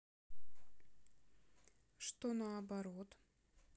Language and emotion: Russian, neutral